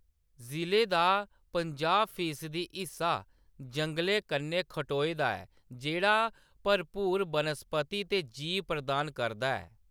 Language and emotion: Dogri, neutral